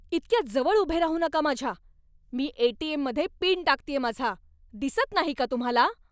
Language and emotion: Marathi, angry